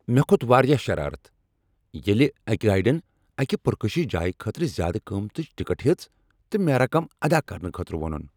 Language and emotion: Kashmiri, angry